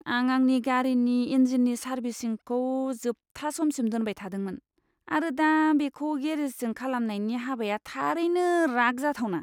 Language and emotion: Bodo, disgusted